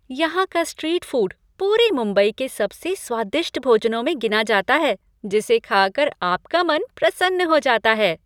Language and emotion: Hindi, happy